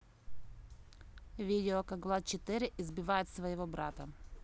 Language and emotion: Russian, neutral